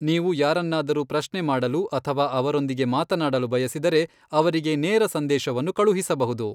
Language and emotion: Kannada, neutral